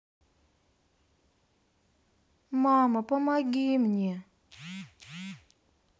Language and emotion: Russian, sad